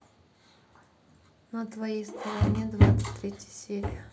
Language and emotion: Russian, neutral